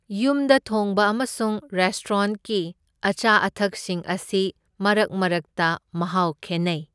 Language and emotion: Manipuri, neutral